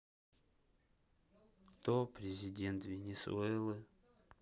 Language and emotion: Russian, sad